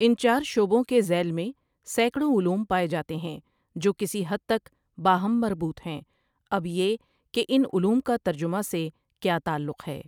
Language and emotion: Urdu, neutral